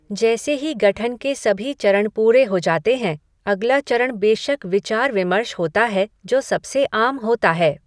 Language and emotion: Hindi, neutral